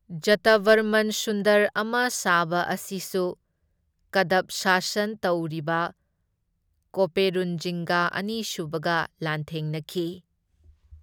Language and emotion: Manipuri, neutral